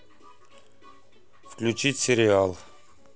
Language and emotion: Russian, neutral